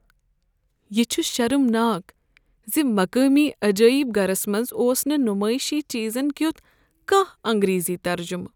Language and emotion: Kashmiri, sad